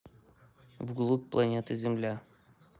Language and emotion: Russian, neutral